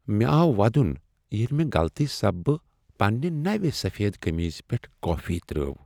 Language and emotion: Kashmiri, sad